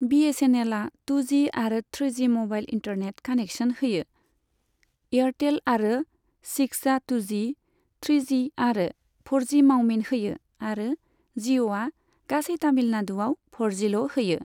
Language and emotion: Bodo, neutral